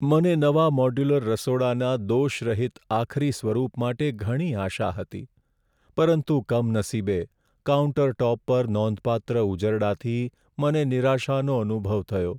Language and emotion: Gujarati, sad